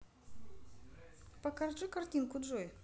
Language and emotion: Russian, neutral